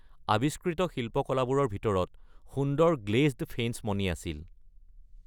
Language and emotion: Assamese, neutral